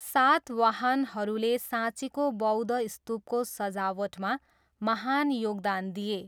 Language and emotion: Nepali, neutral